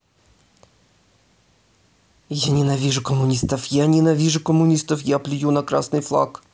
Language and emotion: Russian, angry